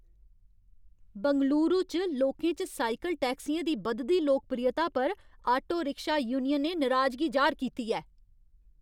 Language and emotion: Dogri, angry